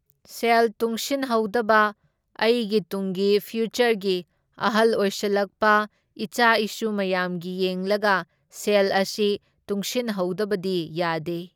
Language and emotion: Manipuri, neutral